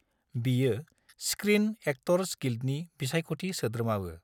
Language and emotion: Bodo, neutral